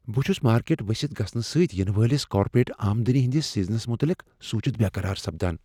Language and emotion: Kashmiri, fearful